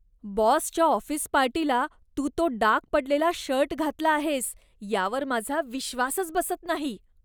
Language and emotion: Marathi, disgusted